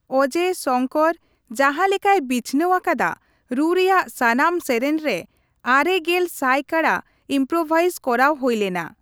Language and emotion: Santali, neutral